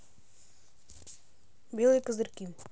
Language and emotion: Russian, neutral